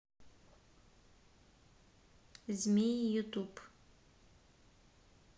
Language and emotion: Russian, neutral